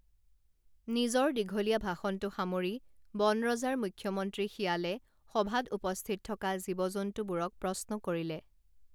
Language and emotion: Assamese, neutral